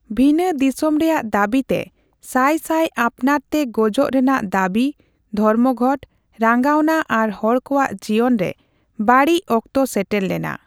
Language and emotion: Santali, neutral